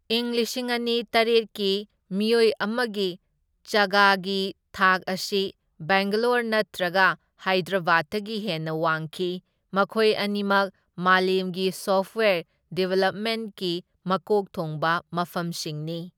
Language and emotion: Manipuri, neutral